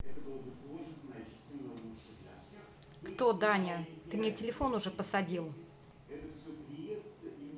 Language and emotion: Russian, angry